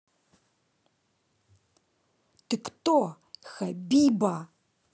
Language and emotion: Russian, angry